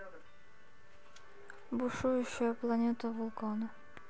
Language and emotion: Russian, neutral